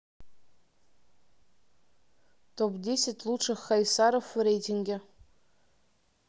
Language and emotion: Russian, neutral